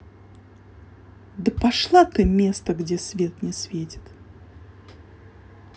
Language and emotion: Russian, angry